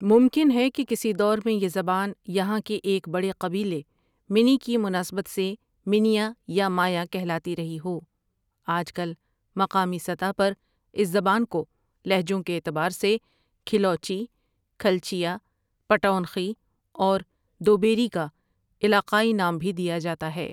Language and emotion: Urdu, neutral